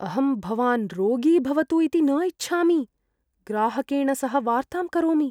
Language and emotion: Sanskrit, fearful